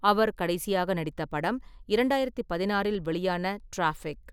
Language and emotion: Tamil, neutral